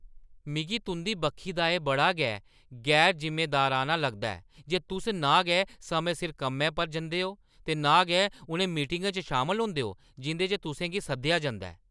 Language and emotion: Dogri, angry